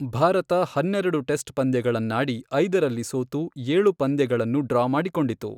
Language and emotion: Kannada, neutral